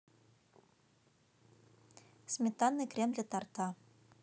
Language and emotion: Russian, neutral